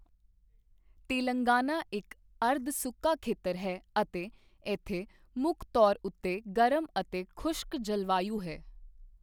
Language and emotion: Punjabi, neutral